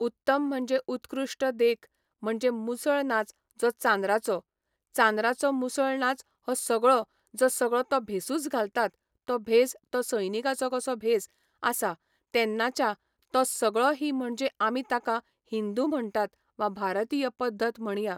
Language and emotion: Goan Konkani, neutral